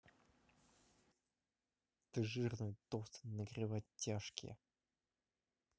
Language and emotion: Russian, angry